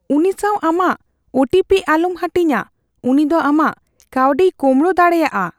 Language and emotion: Santali, fearful